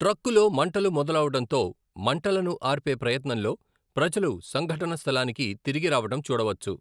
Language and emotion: Telugu, neutral